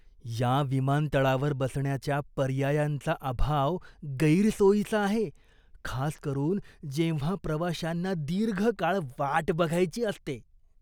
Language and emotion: Marathi, disgusted